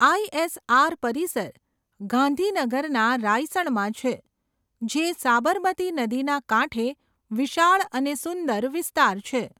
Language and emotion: Gujarati, neutral